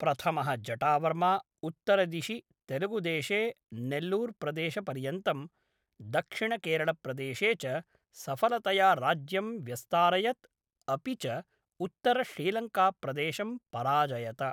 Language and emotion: Sanskrit, neutral